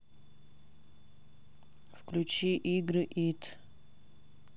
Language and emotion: Russian, neutral